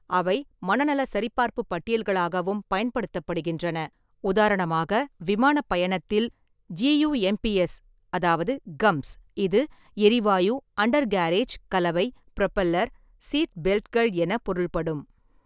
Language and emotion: Tamil, neutral